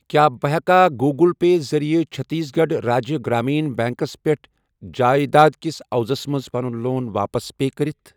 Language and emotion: Kashmiri, neutral